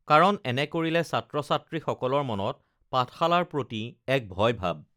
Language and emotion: Assamese, neutral